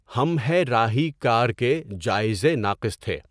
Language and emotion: Urdu, neutral